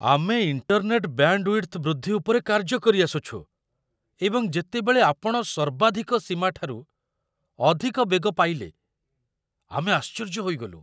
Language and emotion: Odia, surprised